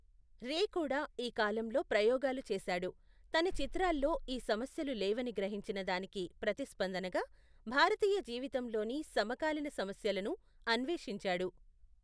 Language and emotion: Telugu, neutral